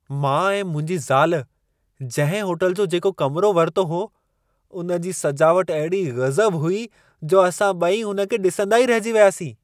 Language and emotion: Sindhi, surprised